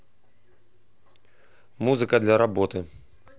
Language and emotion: Russian, neutral